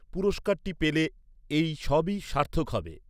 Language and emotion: Bengali, neutral